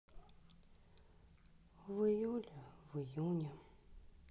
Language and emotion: Russian, sad